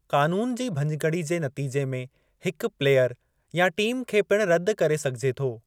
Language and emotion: Sindhi, neutral